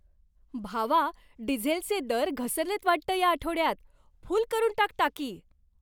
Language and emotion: Marathi, happy